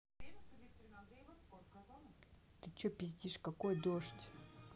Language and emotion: Russian, angry